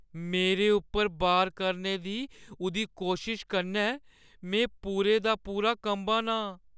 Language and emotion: Dogri, fearful